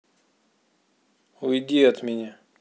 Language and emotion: Russian, angry